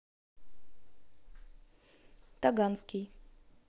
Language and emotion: Russian, neutral